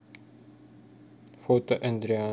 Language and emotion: Russian, neutral